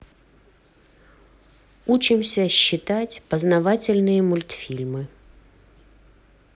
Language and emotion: Russian, neutral